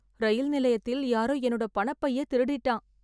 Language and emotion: Tamil, sad